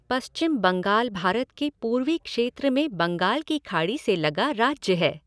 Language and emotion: Hindi, neutral